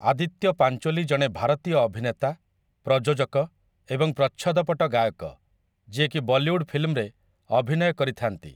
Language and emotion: Odia, neutral